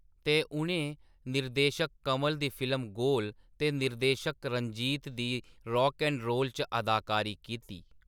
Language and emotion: Dogri, neutral